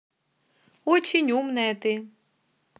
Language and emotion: Russian, positive